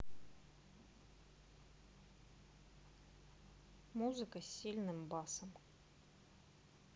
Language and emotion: Russian, neutral